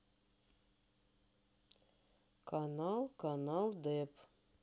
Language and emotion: Russian, neutral